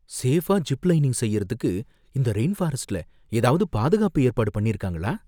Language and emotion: Tamil, fearful